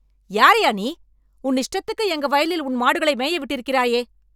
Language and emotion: Tamil, angry